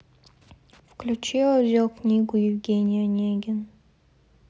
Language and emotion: Russian, sad